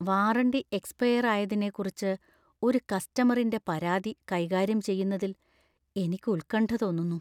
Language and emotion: Malayalam, fearful